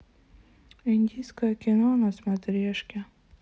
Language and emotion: Russian, sad